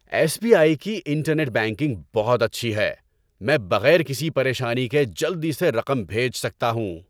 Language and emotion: Urdu, happy